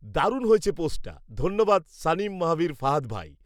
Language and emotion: Bengali, neutral